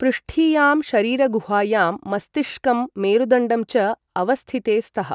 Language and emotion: Sanskrit, neutral